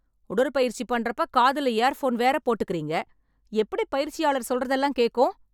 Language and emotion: Tamil, angry